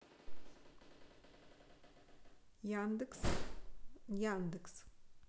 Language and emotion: Russian, neutral